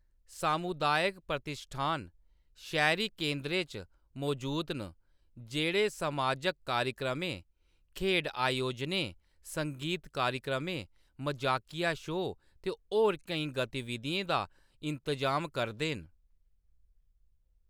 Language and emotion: Dogri, neutral